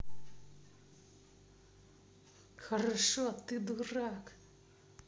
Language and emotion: Russian, angry